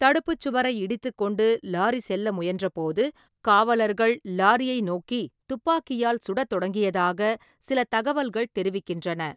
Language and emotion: Tamil, neutral